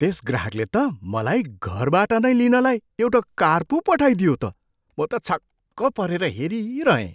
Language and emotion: Nepali, surprised